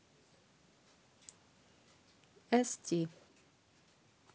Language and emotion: Russian, neutral